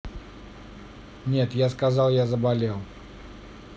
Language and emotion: Russian, neutral